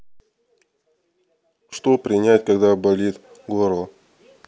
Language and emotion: Russian, neutral